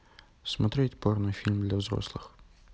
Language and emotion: Russian, neutral